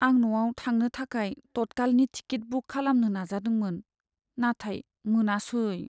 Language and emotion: Bodo, sad